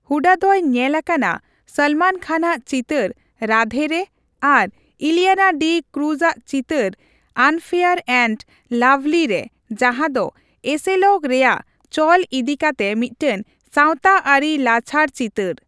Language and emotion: Santali, neutral